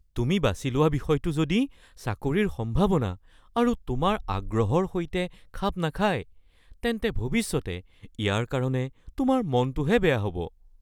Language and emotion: Assamese, fearful